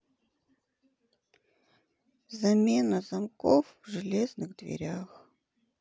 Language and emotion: Russian, sad